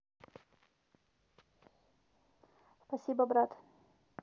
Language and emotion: Russian, neutral